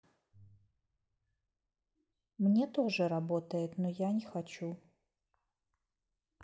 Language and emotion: Russian, neutral